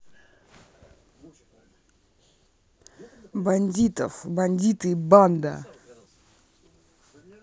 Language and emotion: Russian, neutral